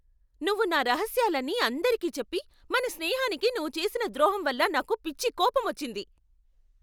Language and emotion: Telugu, angry